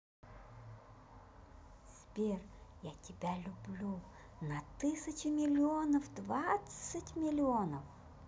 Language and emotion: Russian, positive